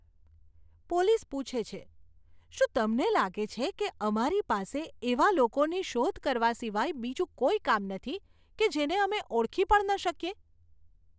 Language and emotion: Gujarati, disgusted